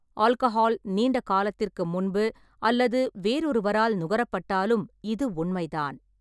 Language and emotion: Tamil, neutral